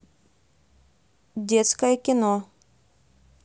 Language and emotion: Russian, neutral